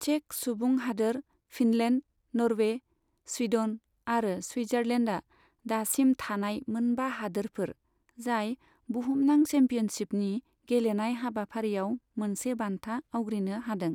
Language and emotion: Bodo, neutral